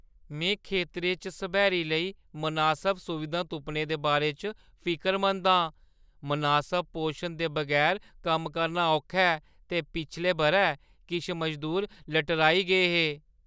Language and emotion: Dogri, fearful